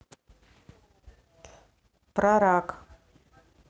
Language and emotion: Russian, neutral